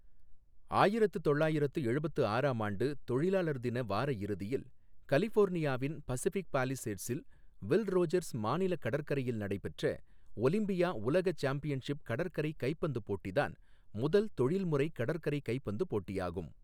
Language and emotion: Tamil, neutral